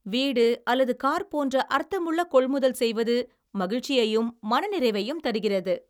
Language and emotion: Tamil, happy